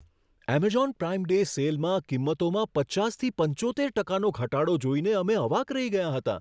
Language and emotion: Gujarati, surprised